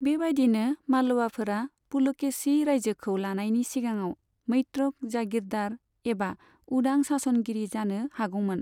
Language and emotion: Bodo, neutral